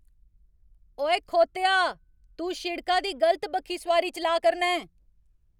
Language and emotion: Dogri, angry